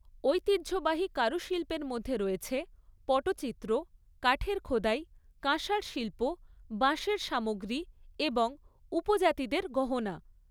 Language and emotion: Bengali, neutral